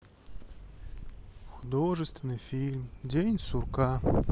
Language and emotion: Russian, sad